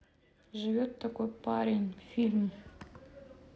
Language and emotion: Russian, neutral